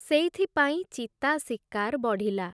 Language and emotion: Odia, neutral